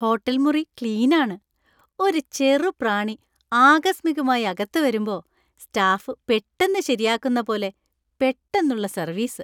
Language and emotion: Malayalam, happy